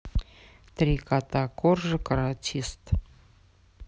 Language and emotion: Russian, neutral